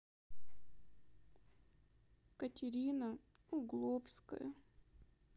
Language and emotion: Russian, sad